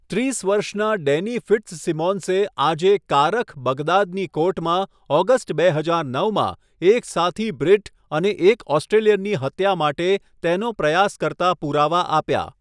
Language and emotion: Gujarati, neutral